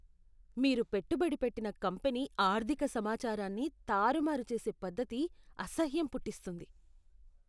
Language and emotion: Telugu, disgusted